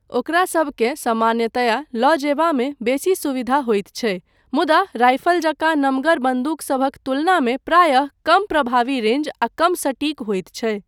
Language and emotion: Maithili, neutral